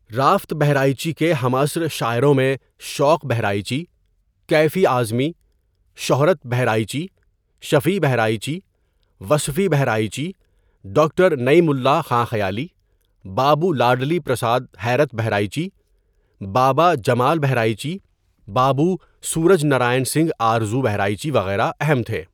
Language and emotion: Urdu, neutral